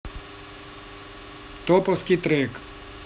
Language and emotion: Russian, neutral